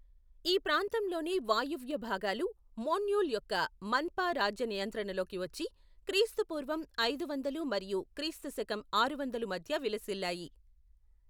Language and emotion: Telugu, neutral